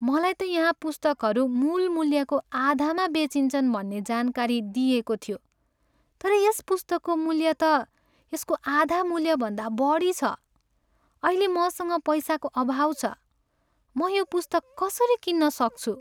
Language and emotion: Nepali, sad